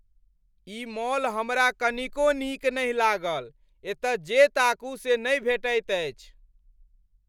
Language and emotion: Maithili, angry